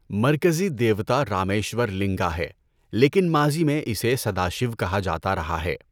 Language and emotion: Urdu, neutral